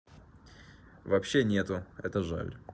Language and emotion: Russian, neutral